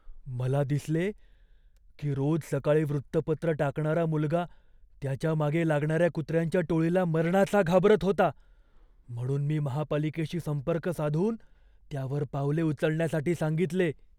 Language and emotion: Marathi, fearful